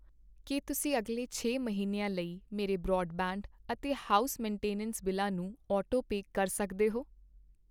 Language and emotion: Punjabi, neutral